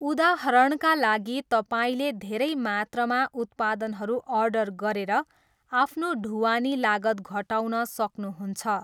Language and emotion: Nepali, neutral